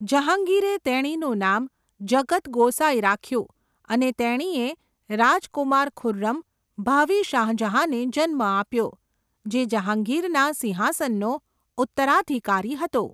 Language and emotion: Gujarati, neutral